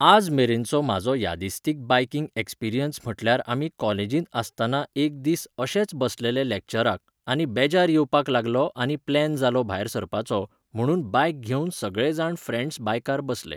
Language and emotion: Goan Konkani, neutral